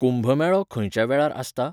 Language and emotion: Goan Konkani, neutral